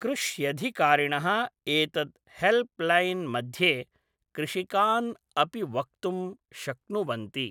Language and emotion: Sanskrit, neutral